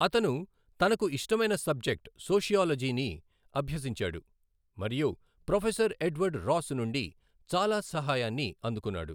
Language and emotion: Telugu, neutral